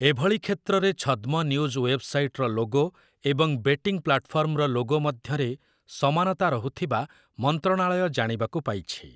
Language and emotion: Odia, neutral